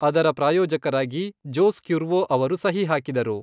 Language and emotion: Kannada, neutral